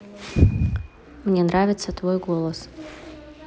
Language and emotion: Russian, neutral